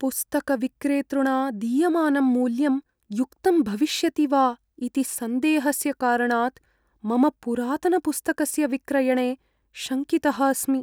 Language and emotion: Sanskrit, fearful